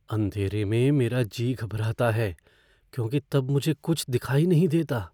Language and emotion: Hindi, fearful